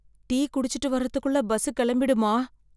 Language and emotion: Tamil, fearful